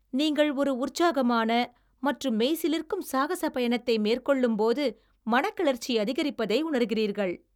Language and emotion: Tamil, happy